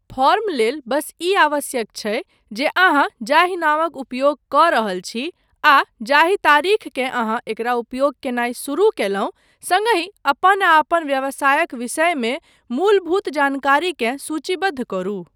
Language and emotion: Maithili, neutral